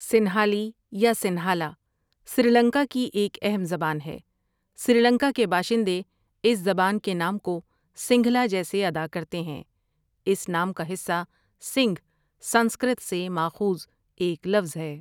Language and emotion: Urdu, neutral